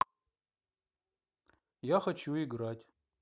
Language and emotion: Russian, neutral